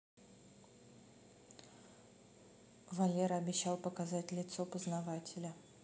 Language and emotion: Russian, neutral